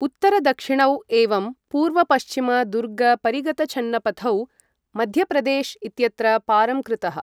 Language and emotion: Sanskrit, neutral